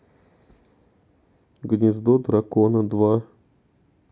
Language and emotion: Russian, neutral